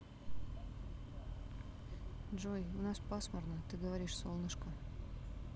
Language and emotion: Russian, sad